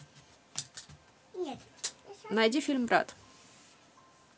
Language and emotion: Russian, neutral